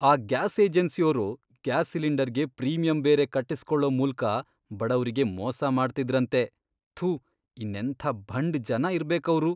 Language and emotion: Kannada, disgusted